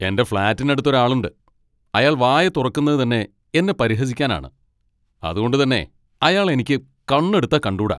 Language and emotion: Malayalam, angry